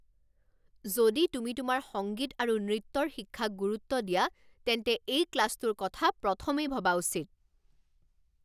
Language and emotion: Assamese, angry